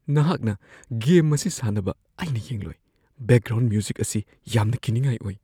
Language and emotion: Manipuri, fearful